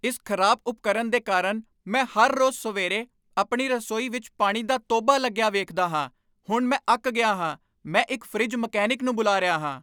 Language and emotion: Punjabi, angry